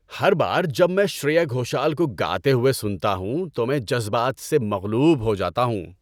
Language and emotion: Urdu, happy